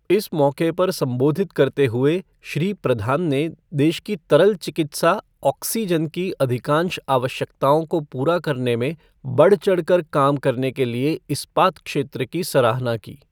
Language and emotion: Hindi, neutral